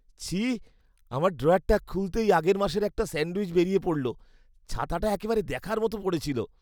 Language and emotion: Bengali, disgusted